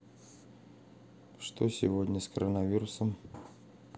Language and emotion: Russian, neutral